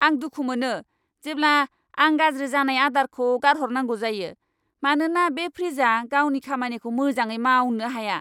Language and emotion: Bodo, angry